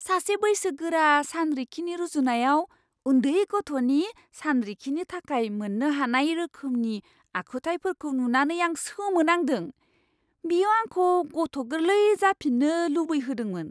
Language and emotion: Bodo, surprised